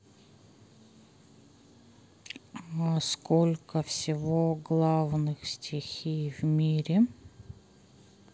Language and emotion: Russian, sad